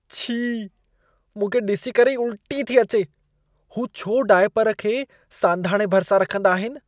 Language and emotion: Sindhi, disgusted